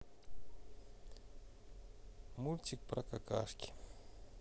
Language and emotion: Russian, neutral